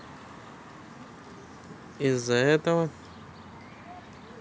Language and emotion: Russian, neutral